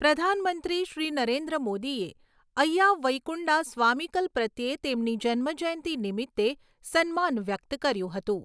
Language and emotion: Gujarati, neutral